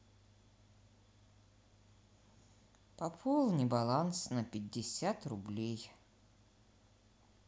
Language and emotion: Russian, neutral